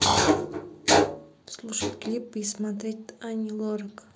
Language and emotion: Russian, neutral